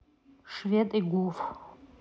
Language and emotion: Russian, neutral